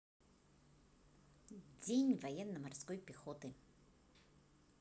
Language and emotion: Russian, positive